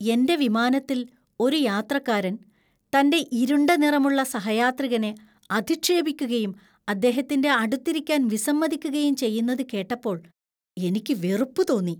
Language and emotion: Malayalam, disgusted